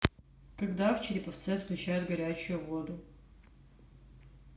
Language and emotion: Russian, neutral